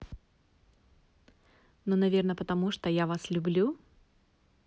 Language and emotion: Russian, positive